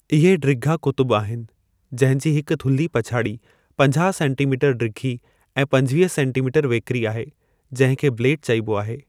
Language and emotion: Sindhi, neutral